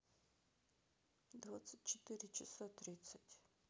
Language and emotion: Russian, neutral